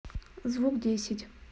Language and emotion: Russian, neutral